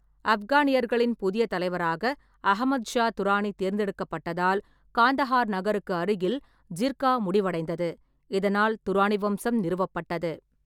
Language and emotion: Tamil, neutral